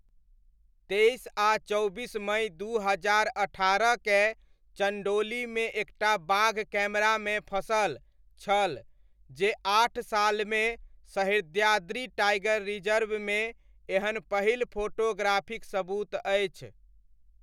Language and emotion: Maithili, neutral